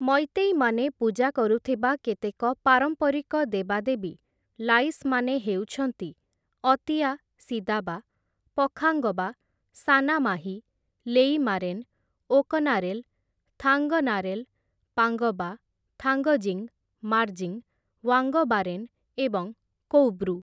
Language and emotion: Odia, neutral